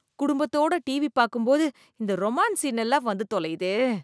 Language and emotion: Tamil, disgusted